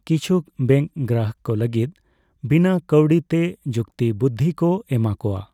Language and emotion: Santali, neutral